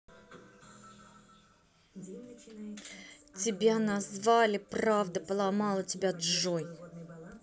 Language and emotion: Russian, angry